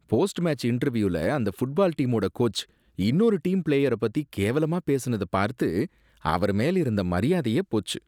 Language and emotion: Tamil, disgusted